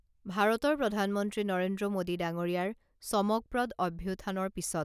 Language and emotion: Assamese, neutral